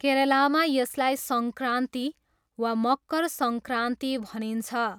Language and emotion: Nepali, neutral